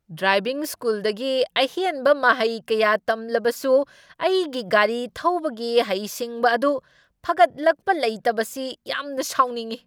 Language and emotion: Manipuri, angry